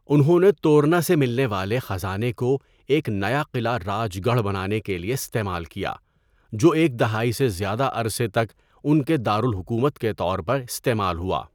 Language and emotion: Urdu, neutral